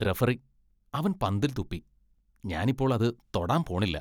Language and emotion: Malayalam, disgusted